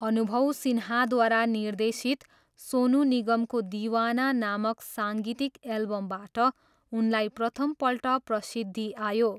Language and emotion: Nepali, neutral